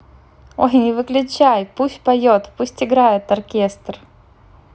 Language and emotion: Russian, positive